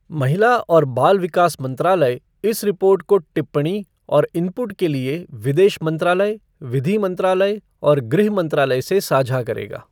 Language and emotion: Hindi, neutral